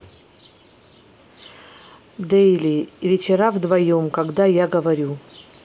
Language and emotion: Russian, neutral